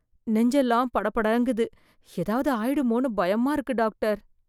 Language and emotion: Tamil, fearful